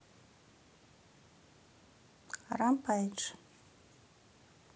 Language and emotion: Russian, neutral